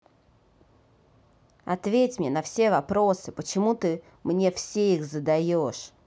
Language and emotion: Russian, angry